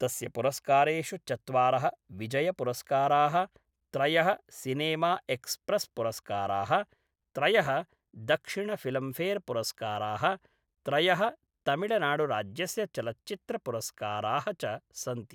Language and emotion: Sanskrit, neutral